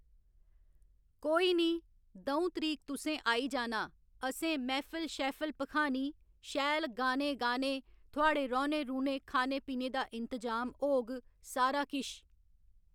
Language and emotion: Dogri, neutral